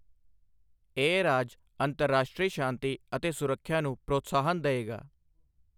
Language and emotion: Punjabi, neutral